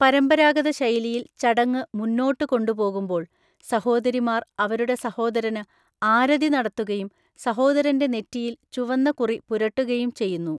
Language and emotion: Malayalam, neutral